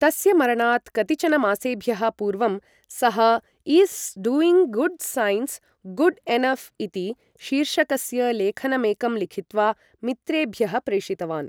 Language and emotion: Sanskrit, neutral